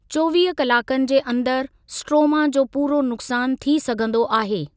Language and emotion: Sindhi, neutral